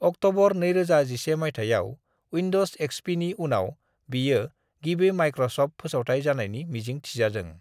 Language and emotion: Bodo, neutral